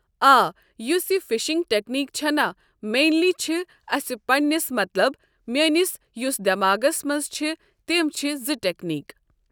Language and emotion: Kashmiri, neutral